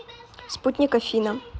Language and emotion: Russian, neutral